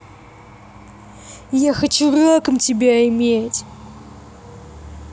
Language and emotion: Russian, angry